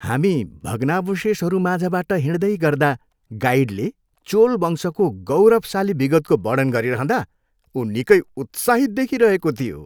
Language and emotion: Nepali, happy